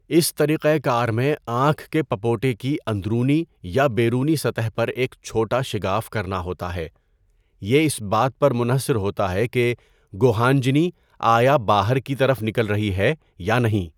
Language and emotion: Urdu, neutral